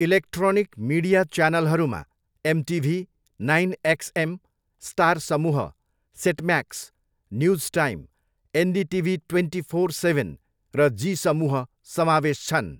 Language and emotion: Nepali, neutral